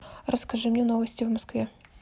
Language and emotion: Russian, neutral